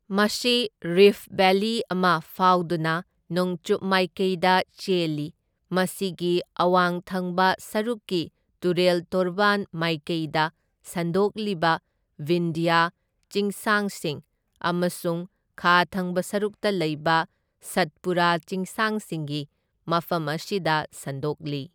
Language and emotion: Manipuri, neutral